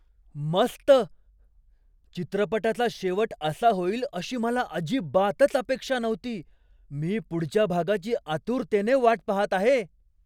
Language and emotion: Marathi, surprised